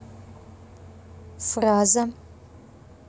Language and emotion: Russian, neutral